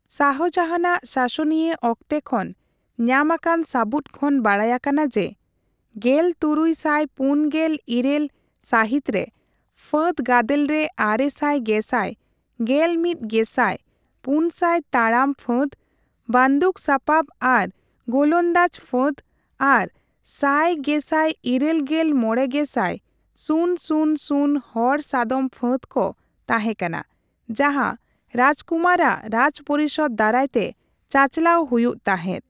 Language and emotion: Santali, neutral